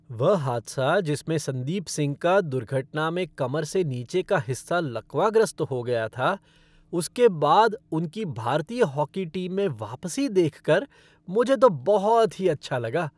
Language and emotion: Hindi, happy